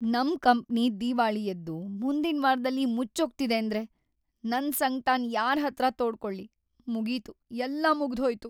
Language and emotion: Kannada, sad